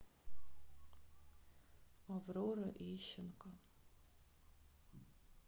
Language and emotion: Russian, sad